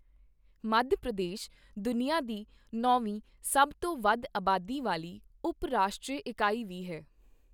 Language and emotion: Punjabi, neutral